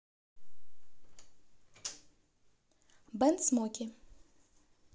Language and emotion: Russian, neutral